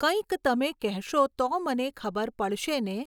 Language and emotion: Gujarati, neutral